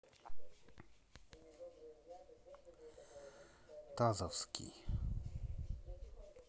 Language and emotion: Russian, neutral